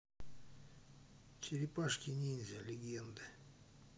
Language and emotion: Russian, neutral